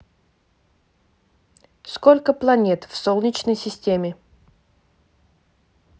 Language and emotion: Russian, neutral